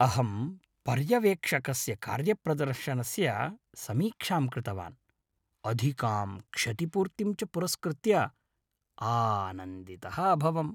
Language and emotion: Sanskrit, happy